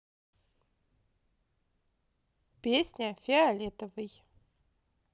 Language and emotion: Russian, positive